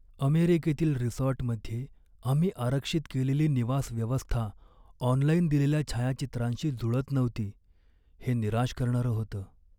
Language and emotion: Marathi, sad